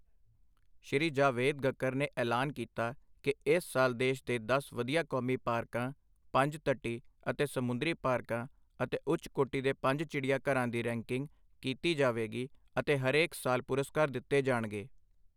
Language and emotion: Punjabi, neutral